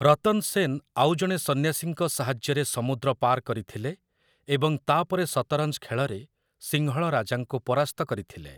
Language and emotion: Odia, neutral